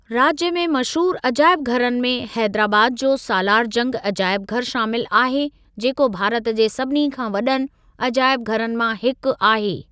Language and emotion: Sindhi, neutral